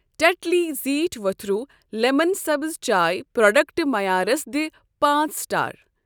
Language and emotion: Kashmiri, neutral